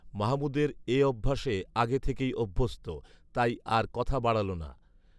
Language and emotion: Bengali, neutral